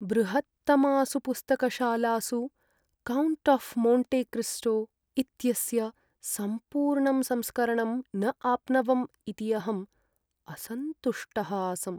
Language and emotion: Sanskrit, sad